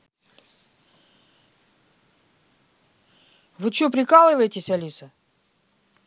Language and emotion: Russian, angry